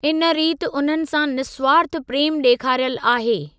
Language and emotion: Sindhi, neutral